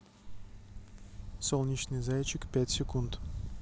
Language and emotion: Russian, neutral